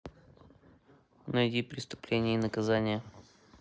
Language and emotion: Russian, neutral